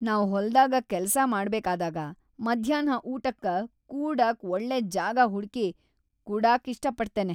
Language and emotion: Kannada, happy